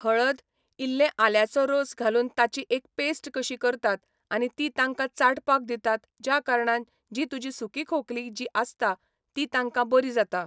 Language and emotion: Goan Konkani, neutral